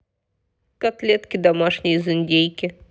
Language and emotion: Russian, neutral